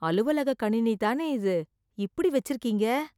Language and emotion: Tamil, disgusted